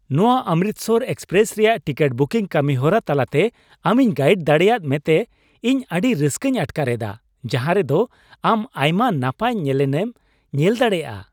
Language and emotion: Santali, happy